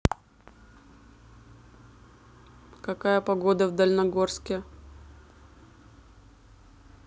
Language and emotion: Russian, neutral